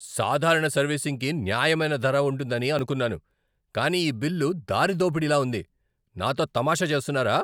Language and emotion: Telugu, angry